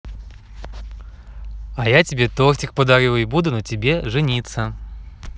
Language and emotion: Russian, positive